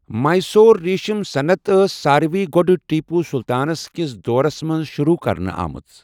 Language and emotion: Kashmiri, neutral